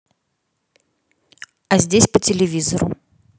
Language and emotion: Russian, neutral